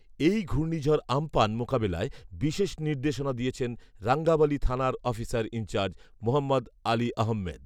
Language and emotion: Bengali, neutral